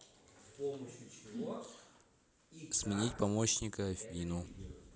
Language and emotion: Russian, neutral